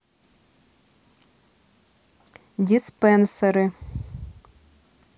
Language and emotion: Russian, neutral